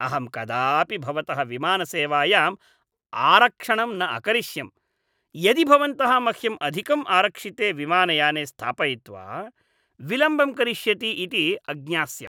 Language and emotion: Sanskrit, disgusted